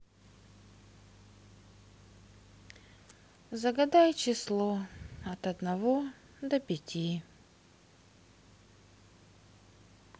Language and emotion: Russian, sad